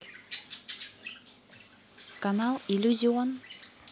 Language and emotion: Russian, neutral